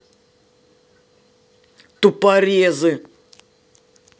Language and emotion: Russian, angry